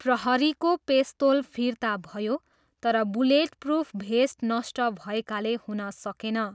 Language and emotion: Nepali, neutral